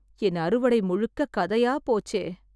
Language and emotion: Tamil, sad